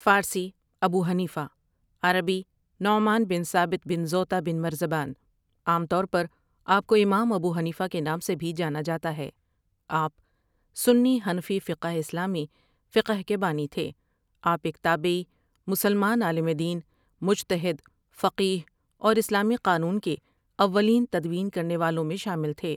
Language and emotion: Urdu, neutral